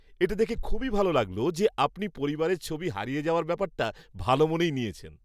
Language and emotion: Bengali, happy